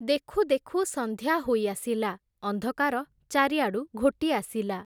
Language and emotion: Odia, neutral